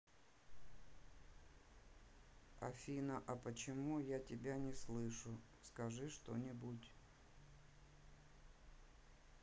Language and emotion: Russian, neutral